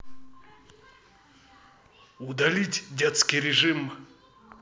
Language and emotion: Russian, neutral